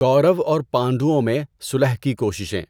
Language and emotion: Urdu, neutral